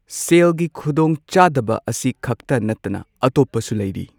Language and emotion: Manipuri, neutral